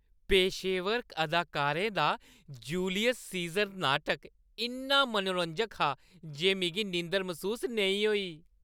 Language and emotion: Dogri, happy